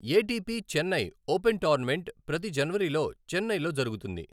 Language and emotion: Telugu, neutral